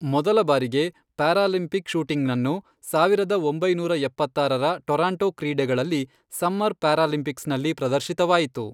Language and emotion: Kannada, neutral